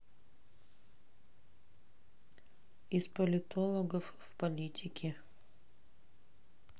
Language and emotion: Russian, neutral